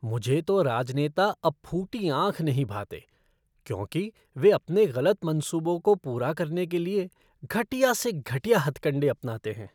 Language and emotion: Hindi, disgusted